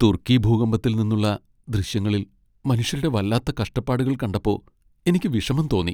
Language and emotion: Malayalam, sad